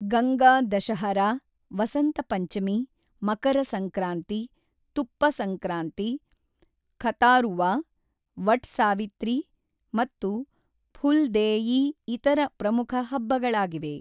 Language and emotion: Kannada, neutral